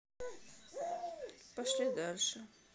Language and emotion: Russian, sad